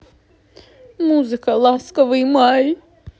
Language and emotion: Russian, sad